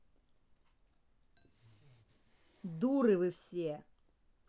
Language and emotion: Russian, angry